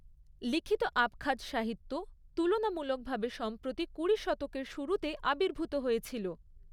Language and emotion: Bengali, neutral